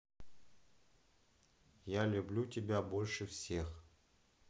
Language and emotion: Russian, neutral